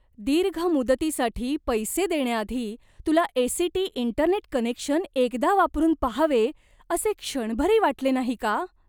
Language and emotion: Marathi, disgusted